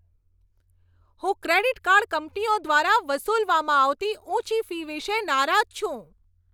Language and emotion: Gujarati, angry